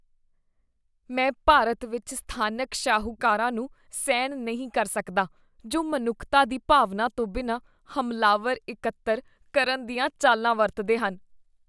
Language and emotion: Punjabi, disgusted